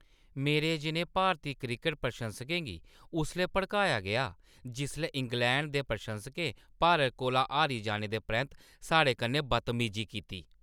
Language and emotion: Dogri, angry